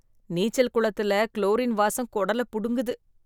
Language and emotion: Tamil, disgusted